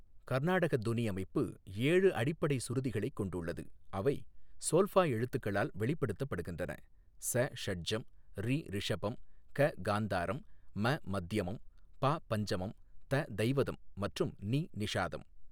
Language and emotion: Tamil, neutral